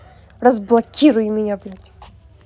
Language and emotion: Russian, angry